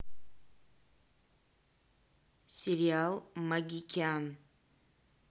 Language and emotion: Russian, neutral